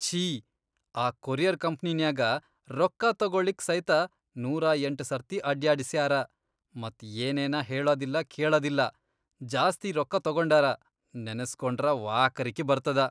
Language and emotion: Kannada, disgusted